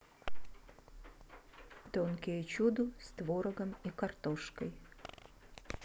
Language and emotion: Russian, neutral